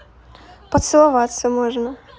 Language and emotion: Russian, positive